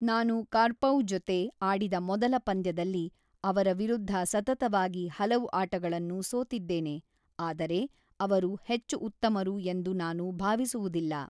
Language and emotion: Kannada, neutral